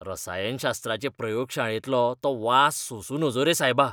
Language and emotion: Goan Konkani, disgusted